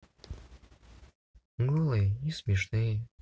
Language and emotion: Russian, neutral